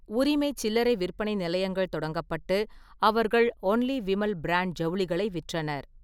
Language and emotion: Tamil, neutral